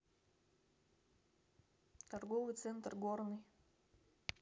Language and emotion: Russian, neutral